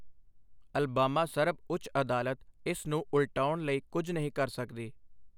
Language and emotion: Punjabi, neutral